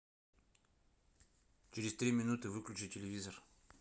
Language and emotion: Russian, neutral